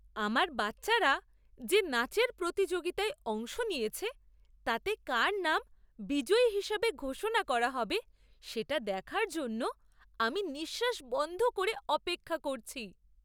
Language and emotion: Bengali, surprised